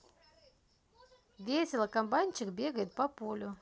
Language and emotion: Russian, positive